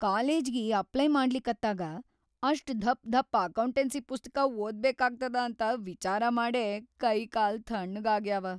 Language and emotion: Kannada, fearful